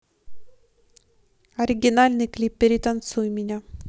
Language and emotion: Russian, neutral